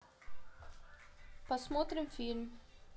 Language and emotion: Russian, neutral